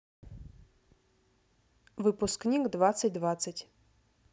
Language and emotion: Russian, neutral